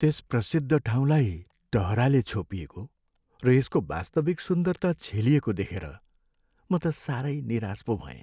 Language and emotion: Nepali, sad